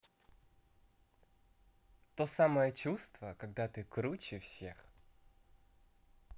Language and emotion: Russian, positive